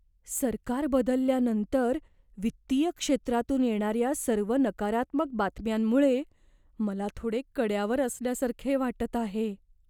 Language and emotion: Marathi, fearful